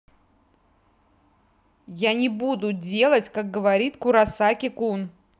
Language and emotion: Russian, angry